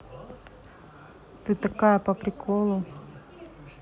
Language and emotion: Russian, neutral